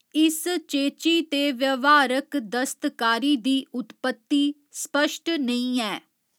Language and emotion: Dogri, neutral